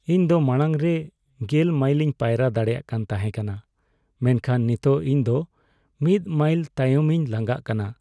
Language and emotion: Santali, sad